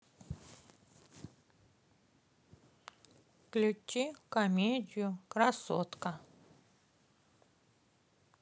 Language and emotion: Russian, neutral